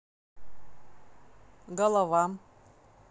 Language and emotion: Russian, neutral